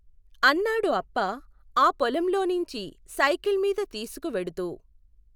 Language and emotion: Telugu, neutral